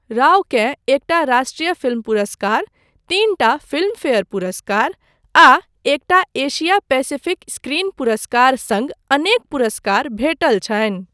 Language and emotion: Maithili, neutral